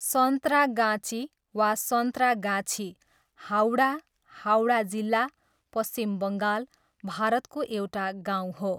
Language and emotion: Nepali, neutral